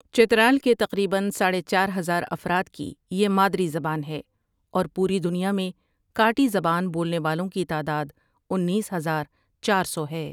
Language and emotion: Urdu, neutral